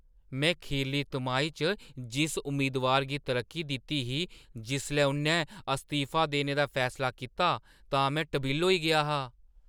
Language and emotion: Dogri, surprised